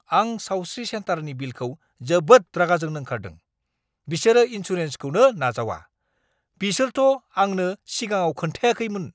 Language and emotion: Bodo, angry